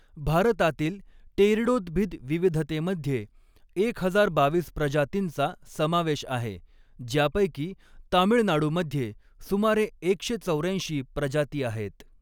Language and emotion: Marathi, neutral